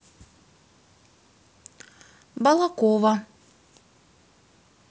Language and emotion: Russian, neutral